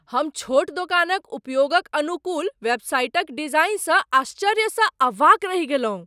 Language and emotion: Maithili, surprised